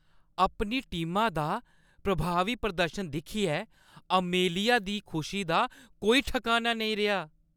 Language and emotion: Dogri, happy